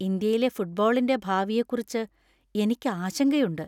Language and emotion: Malayalam, fearful